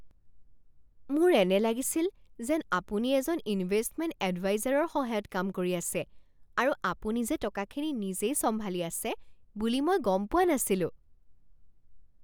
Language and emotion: Assamese, surprised